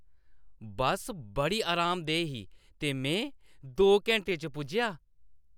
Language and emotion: Dogri, happy